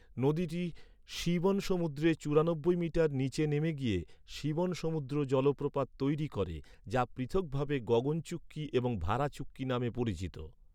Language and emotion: Bengali, neutral